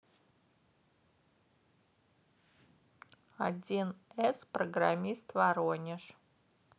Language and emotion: Russian, neutral